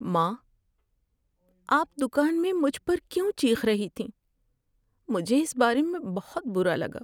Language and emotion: Urdu, sad